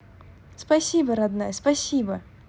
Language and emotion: Russian, positive